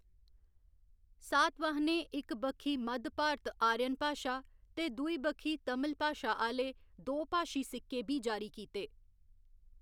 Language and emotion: Dogri, neutral